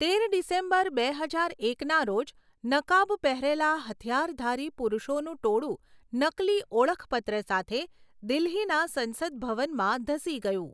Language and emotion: Gujarati, neutral